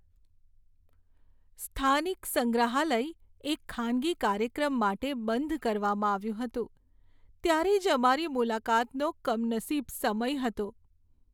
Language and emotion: Gujarati, sad